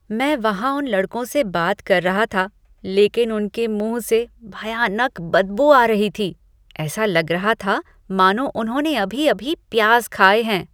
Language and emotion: Hindi, disgusted